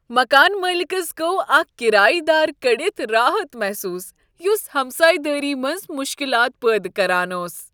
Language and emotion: Kashmiri, happy